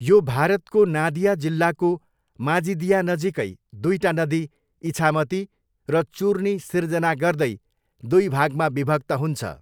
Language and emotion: Nepali, neutral